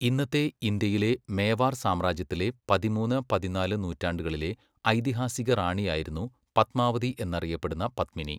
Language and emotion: Malayalam, neutral